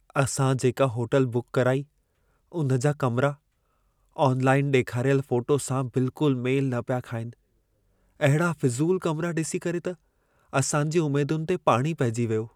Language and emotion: Sindhi, sad